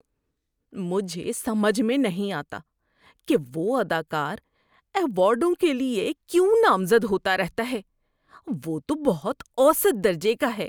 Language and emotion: Urdu, disgusted